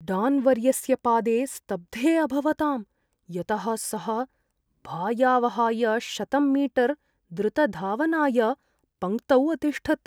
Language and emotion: Sanskrit, fearful